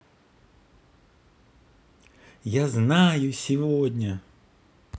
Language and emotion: Russian, positive